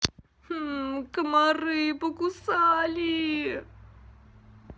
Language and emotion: Russian, sad